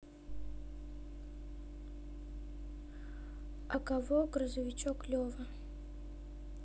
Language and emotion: Russian, neutral